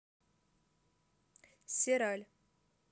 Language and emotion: Russian, neutral